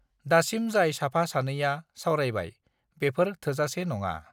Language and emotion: Bodo, neutral